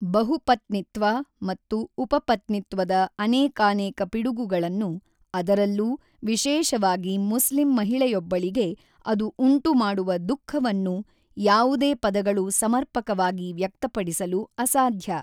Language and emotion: Kannada, neutral